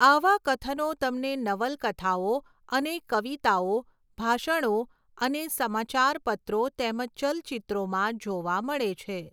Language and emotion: Gujarati, neutral